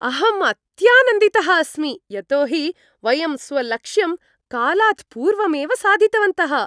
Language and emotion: Sanskrit, happy